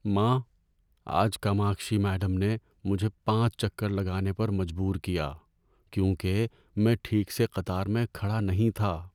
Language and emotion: Urdu, sad